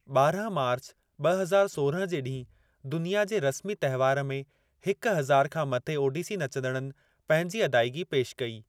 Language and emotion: Sindhi, neutral